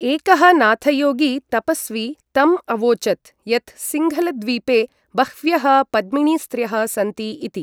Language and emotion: Sanskrit, neutral